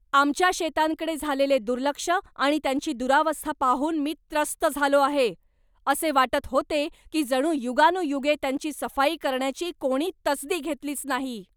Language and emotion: Marathi, angry